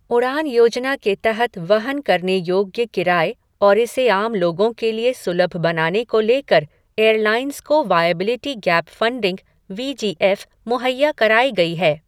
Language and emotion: Hindi, neutral